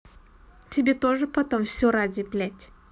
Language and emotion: Russian, angry